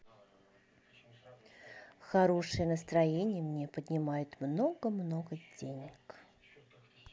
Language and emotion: Russian, positive